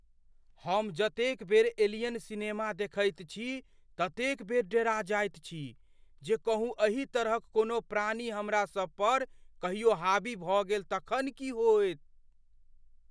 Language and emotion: Maithili, fearful